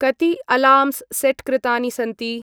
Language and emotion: Sanskrit, neutral